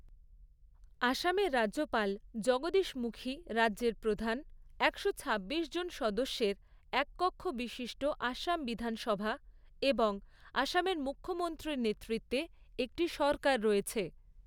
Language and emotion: Bengali, neutral